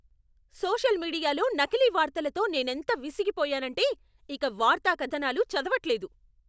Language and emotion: Telugu, angry